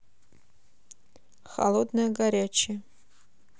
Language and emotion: Russian, neutral